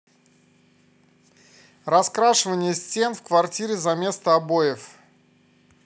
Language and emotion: Russian, positive